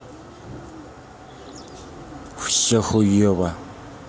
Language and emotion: Russian, angry